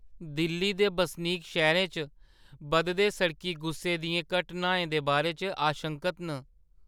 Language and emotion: Dogri, fearful